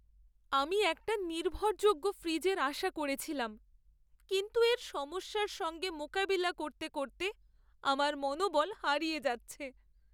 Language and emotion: Bengali, sad